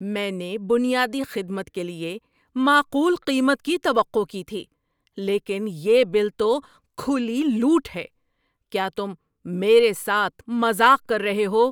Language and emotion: Urdu, angry